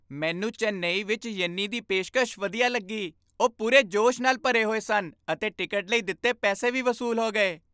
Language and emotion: Punjabi, happy